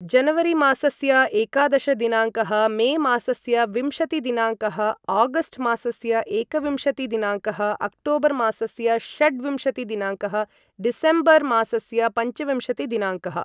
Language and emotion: Sanskrit, neutral